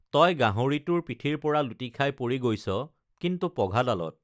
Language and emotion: Assamese, neutral